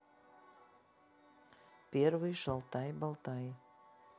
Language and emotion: Russian, neutral